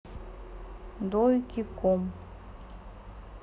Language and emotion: Russian, neutral